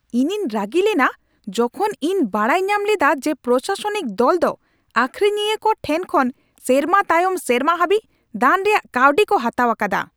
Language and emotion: Santali, angry